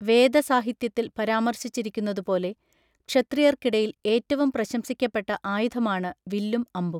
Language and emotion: Malayalam, neutral